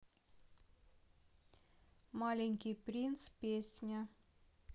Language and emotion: Russian, neutral